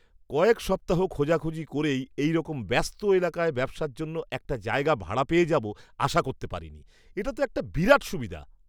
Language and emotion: Bengali, surprised